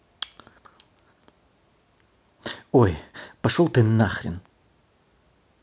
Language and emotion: Russian, angry